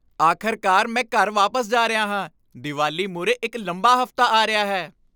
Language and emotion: Punjabi, happy